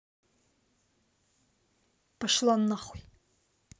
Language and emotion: Russian, angry